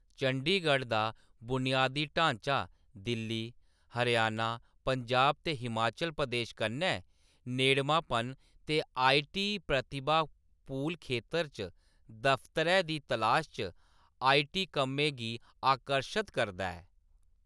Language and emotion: Dogri, neutral